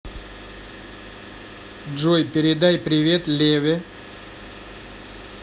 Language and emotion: Russian, neutral